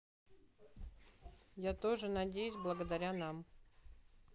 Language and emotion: Russian, neutral